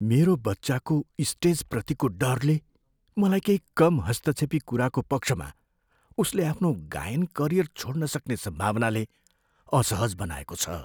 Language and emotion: Nepali, fearful